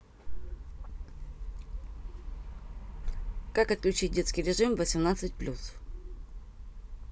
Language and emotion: Russian, neutral